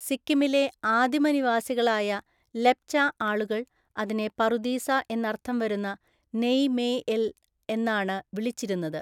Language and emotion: Malayalam, neutral